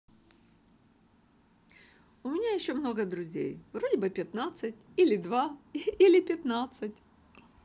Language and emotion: Russian, positive